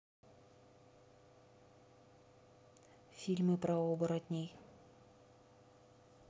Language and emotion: Russian, neutral